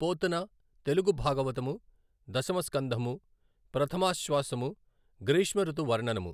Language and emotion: Telugu, neutral